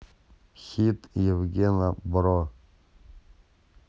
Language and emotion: Russian, neutral